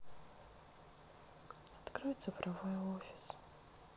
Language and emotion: Russian, sad